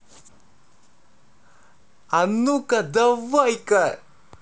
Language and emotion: Russian, positive